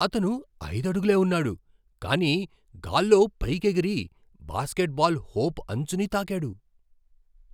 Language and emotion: Telugu, surprised